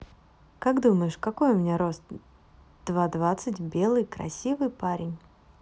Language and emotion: Russian, positive